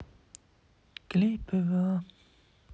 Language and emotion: Russian, sad